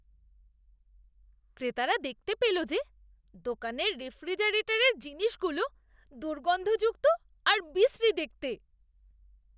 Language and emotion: Bengali, disgusted